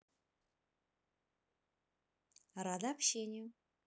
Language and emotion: Russian, positive